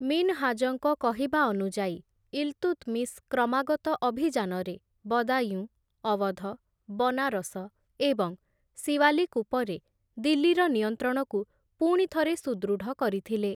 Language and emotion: Odia, neutral